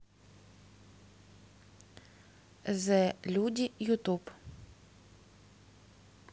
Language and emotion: Russian, neutral